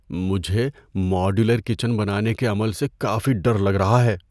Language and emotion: Urdu, fearful